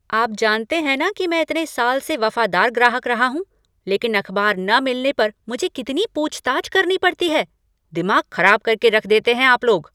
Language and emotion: Hindi, angry